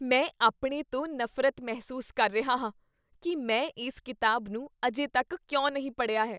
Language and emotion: Punjabi, disgusted